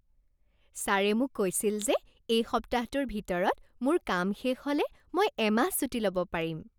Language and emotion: Assamese, happy